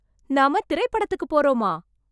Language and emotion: Tamil, surprised